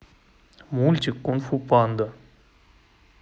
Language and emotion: Russian, neutral